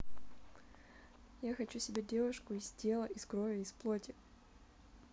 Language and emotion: Russian, positive